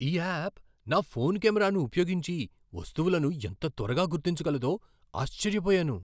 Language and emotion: Telugu, surprised